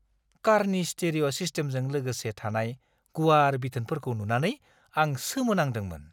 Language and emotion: Bodo, surprised